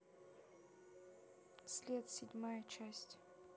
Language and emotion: Russian, neutral